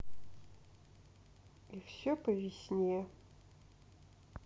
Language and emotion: Russian, sad